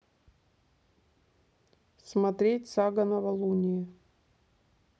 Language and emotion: Russian, neutral